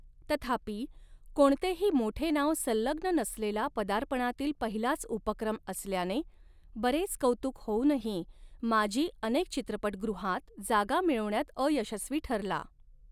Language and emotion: Marathi, neutral